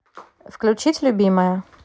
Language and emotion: Russian, neutral